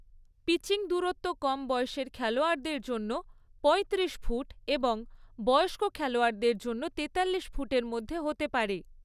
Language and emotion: Bengali, neutral